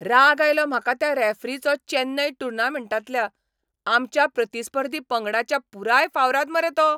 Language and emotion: Goan Konkani, angry